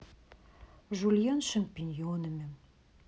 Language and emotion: Russian, neutral